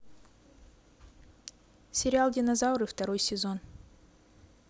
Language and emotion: Russian, neutral